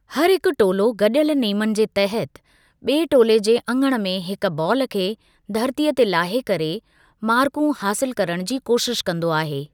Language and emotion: Sindhi, neutral